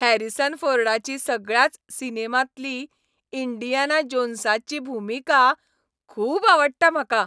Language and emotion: Goan Konkani, happy